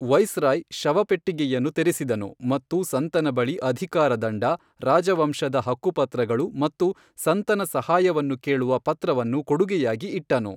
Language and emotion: Kannada, neutral